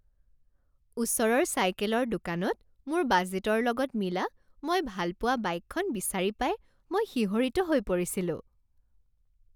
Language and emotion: Assamese, happy